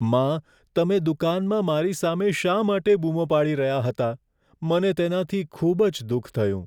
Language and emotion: Gujarati, sad